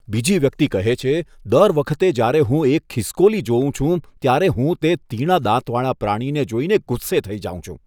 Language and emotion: Gujarati, disgusted